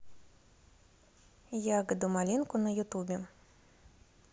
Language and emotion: Russian, neutral